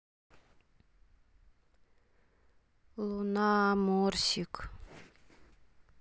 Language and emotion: Russian, sad